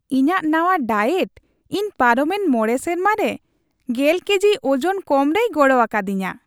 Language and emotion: Santali, happy